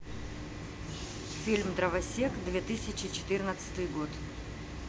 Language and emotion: Russian, neutral